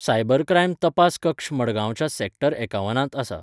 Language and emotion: Goan Konkani, neutral